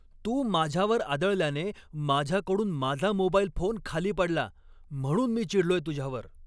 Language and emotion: Marathi, angry